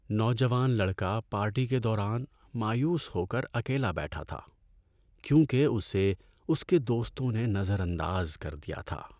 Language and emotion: Urdu, sad